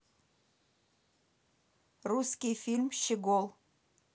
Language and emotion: Russian, neutral